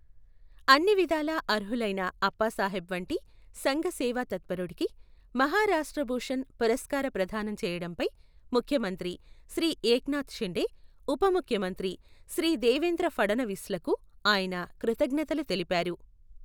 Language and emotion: Telugu, neutral